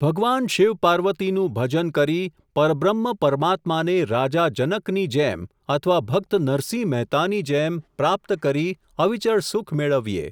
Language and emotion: Gujarati, neutral